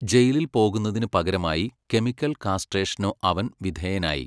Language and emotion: Malayalam, neutral